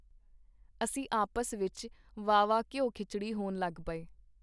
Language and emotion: Punjabi, neutral